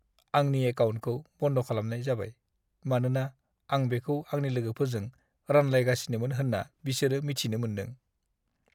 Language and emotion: Bodo, sad